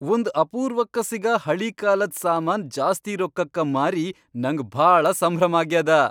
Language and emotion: Kannada, happy